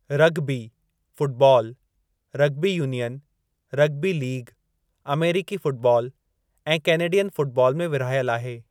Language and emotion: Sindhi, neutral